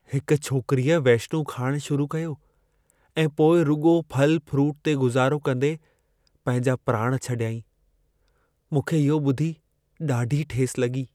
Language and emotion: Sindhi, sad